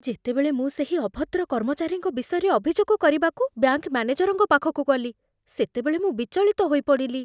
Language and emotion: Odia, fearful